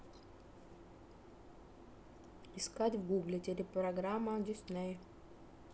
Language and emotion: Russian, neutral